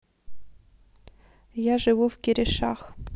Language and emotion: Russian, neutral